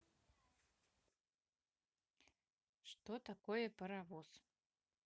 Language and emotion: Russian, neutral